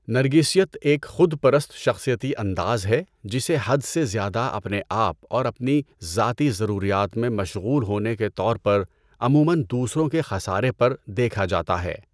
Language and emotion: Urdu, neutral